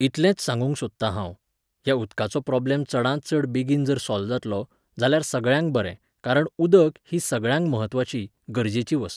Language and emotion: Goan Konkani, neutral